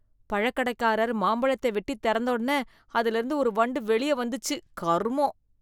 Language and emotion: Tamil, disgusted